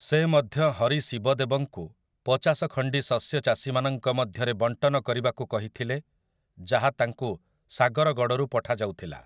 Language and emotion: Odia, neutral